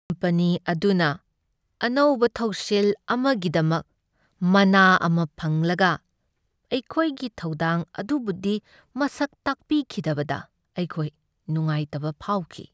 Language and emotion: Manipuri, sad